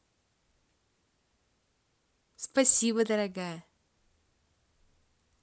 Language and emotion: Russian, positive